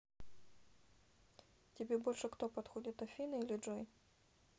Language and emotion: Russian, neutral